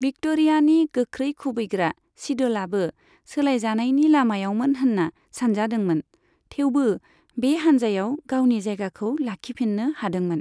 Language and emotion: Bodo, neutral